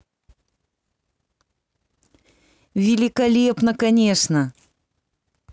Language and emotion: Russian, positive